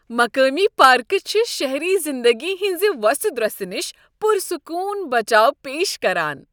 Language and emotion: Kashmiri, happy